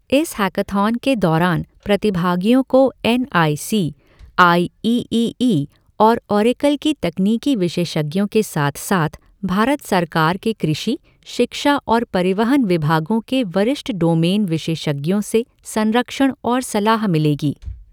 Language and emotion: Hindi, neutral